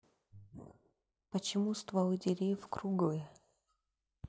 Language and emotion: Russian, neutral